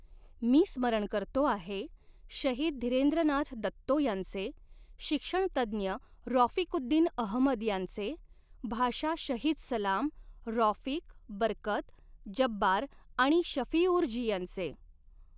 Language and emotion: Marathi, neutral